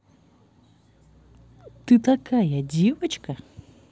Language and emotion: Russian, positive